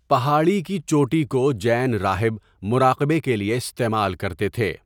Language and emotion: Urdu, neutral